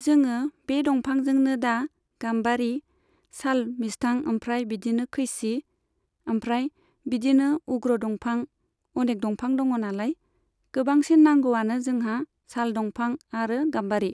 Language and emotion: Bodo, neutral